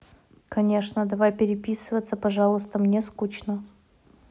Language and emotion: Russian, neutral